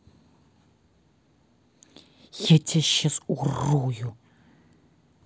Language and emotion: Russian, angry